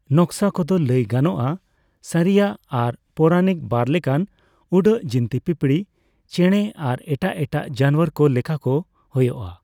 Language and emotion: Santali, neutral